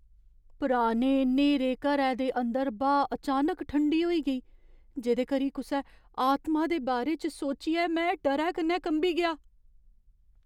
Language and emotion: Dogri, fearful